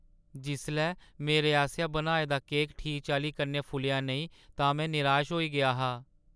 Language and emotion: Dogri, sad